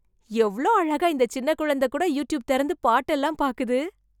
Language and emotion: Tamil, surprised